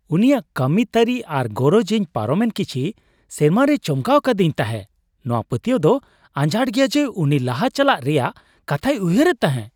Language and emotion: Santali, surprised